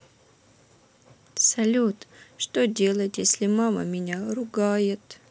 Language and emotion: Russian, sad